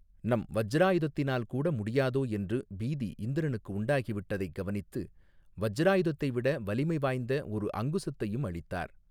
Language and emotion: Tamil, neutral